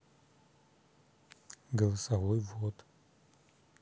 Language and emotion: Russian, neutral